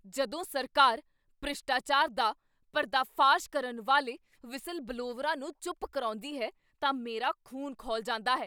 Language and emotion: Punjabi, angry